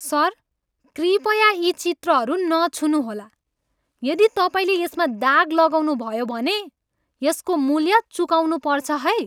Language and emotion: Nepali, angry